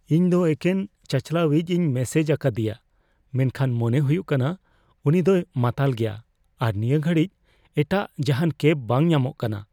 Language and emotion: Santali, fearful